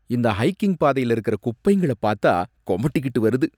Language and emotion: Tamil, disgusted